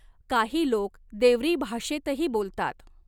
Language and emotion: Marathi, neutral